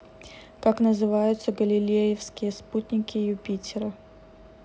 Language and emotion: Russian, neutral